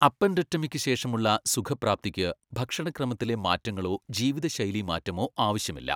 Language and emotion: Malayalam, neutral